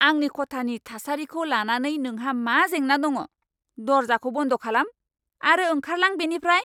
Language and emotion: Bodo, angry